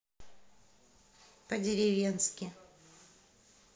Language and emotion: Russian, neutral